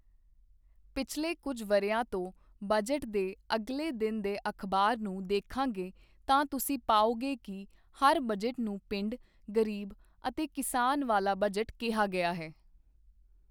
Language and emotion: Punjabi, neutral